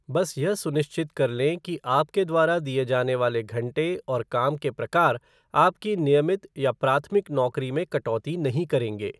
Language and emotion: Hindi, neutral